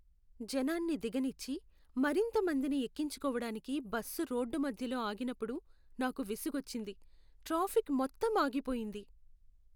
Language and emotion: Telugu, sad